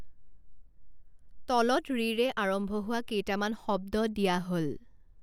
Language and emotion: Assamese, neutral